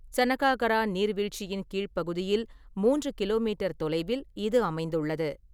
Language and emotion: Tamil, neutral